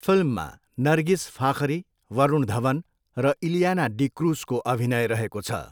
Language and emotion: Nepali, neutral